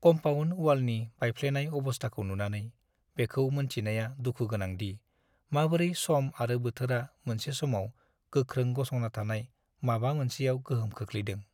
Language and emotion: Bodo, sad